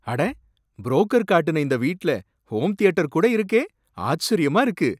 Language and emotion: Tamil, surprised